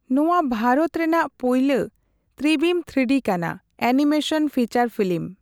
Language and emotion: Santali, neutral